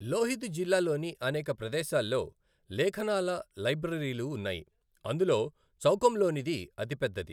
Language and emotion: Telugu, neutral